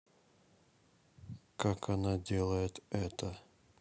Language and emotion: Russian, neutral